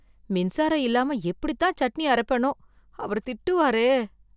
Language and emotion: Tamil, fearful